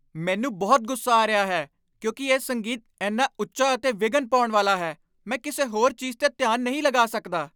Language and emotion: Punjabi, angry